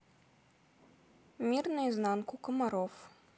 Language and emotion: Russian, neutral